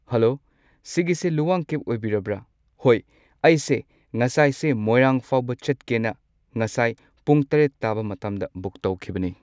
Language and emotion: Manipuri, neutral